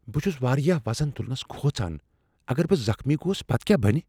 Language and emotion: Kashmiri, fearful